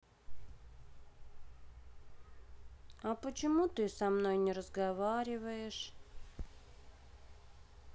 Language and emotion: Russian, sad